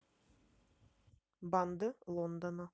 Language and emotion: Russian, neutral